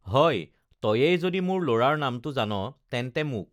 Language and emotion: Assamese, neutral